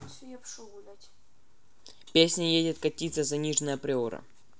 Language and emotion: Russian, neutral